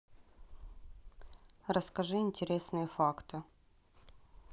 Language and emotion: Russian, neutral